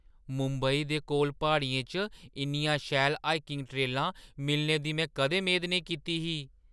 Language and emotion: Dogri, surprised